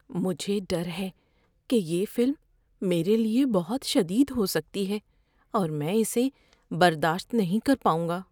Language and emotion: Urdu, fearful